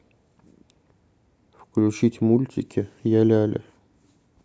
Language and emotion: Russian, neutral